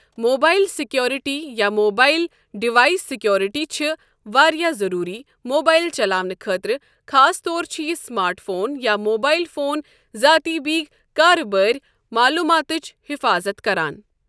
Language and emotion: Kashmiri, neutral